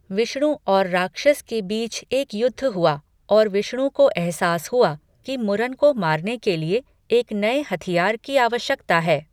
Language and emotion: Hindi, neutral